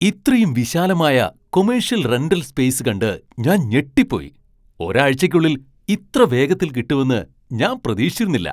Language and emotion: Malayalam, surprised